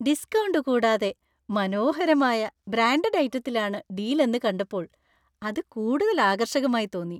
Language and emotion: Malayalam, happy